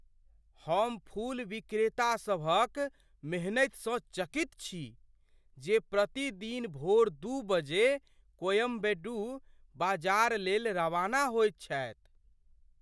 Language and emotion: Maithili, surprised